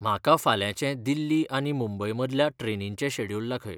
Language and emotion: Goan Konkani, neutral